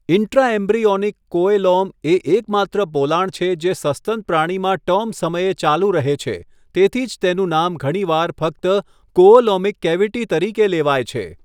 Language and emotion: Gujarati, neutral